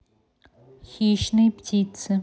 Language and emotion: Russian, neutral